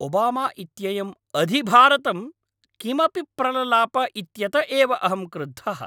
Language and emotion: Sanskrit, angry